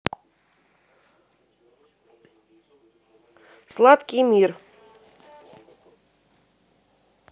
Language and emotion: Russian, positive